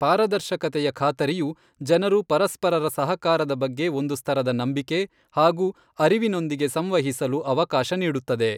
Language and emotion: Kannada, neutral